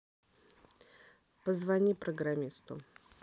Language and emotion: Russian, neutral